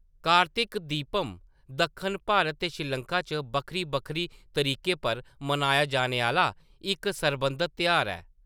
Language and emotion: Dogri, neutral